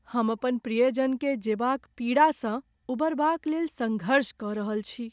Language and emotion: Maithili, sad